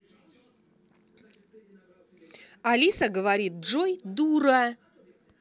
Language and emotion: Russian, angry